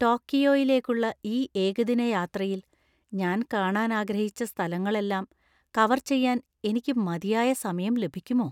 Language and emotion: Malayalam, fearful